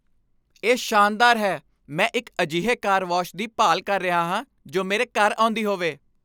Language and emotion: Punjabi, happy